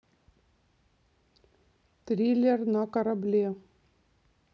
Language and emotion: Russian, neutral